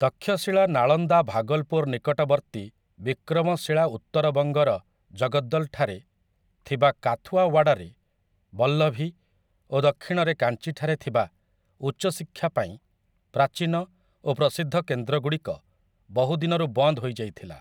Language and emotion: Odia, neutral